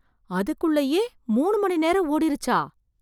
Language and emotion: Tamil, surprised